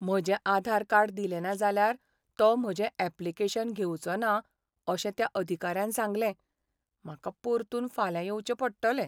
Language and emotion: Goan Konkani, sad